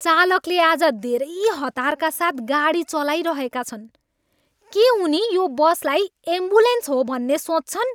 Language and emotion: Nepali, angry